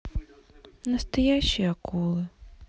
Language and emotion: Russian, sad